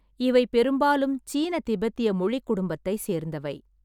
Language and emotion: Tamil, neutral